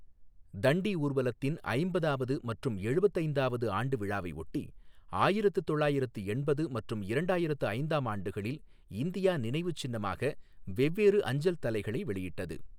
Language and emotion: Tamil, neutral